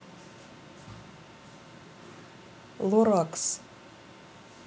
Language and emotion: Russian, neutral